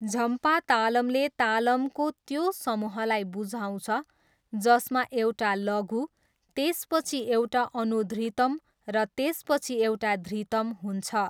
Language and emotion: Nepali, neutral